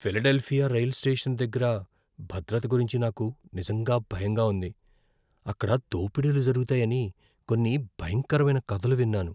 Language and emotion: Telugu, fearful